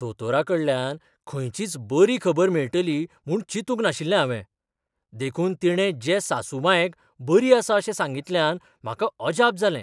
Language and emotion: Goan Konkani, surprised